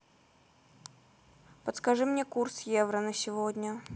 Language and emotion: Russian, neutral